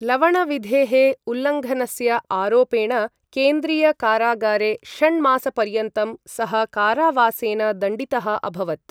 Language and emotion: Sanskrit, neutral